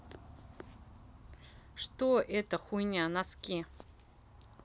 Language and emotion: Russian, neutral